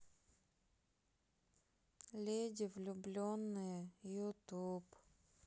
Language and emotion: Russian, sad